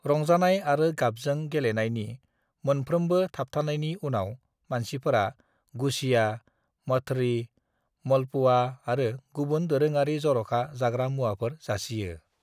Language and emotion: Bodo, neutral